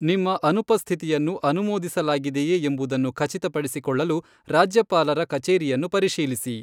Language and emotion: Kannada, neutral